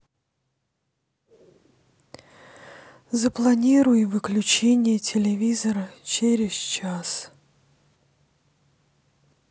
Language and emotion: Russian, sad